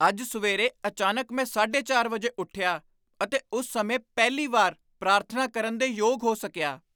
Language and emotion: Punjabi, surprised